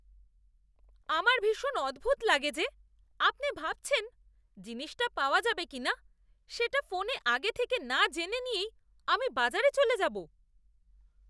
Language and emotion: Bengali, disgusted